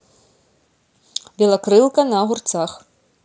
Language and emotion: Russian, neutral